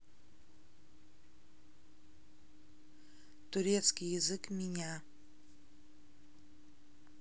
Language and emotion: Russian, neutral